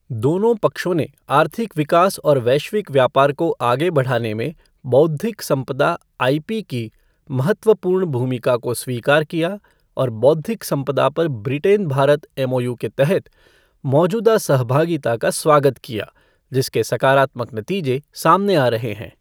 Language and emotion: Hindi, neutral